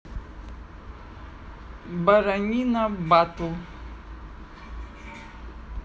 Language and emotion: Russian, neutral